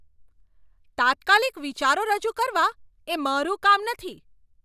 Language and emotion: Gujarati, angry